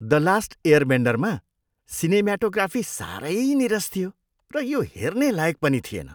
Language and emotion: Nepali, disgusted